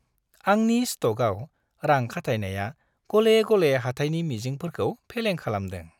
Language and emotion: Bodo, happy